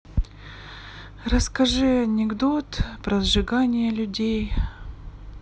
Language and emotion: Russian, sad